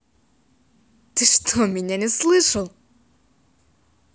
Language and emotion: Russian, positive